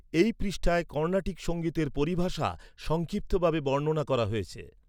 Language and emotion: Bengali, neutral